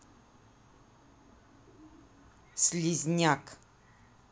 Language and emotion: Russian, angry